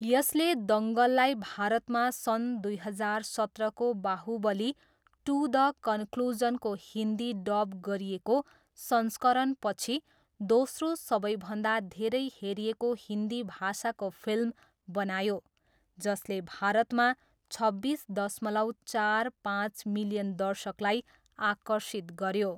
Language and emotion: Nepali, neutral